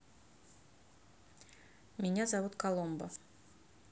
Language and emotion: Russian, neutral